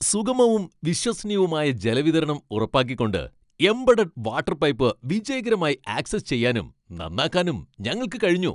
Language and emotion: Malayalam, happy